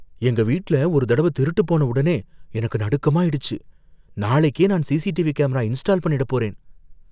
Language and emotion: Tamil, fearful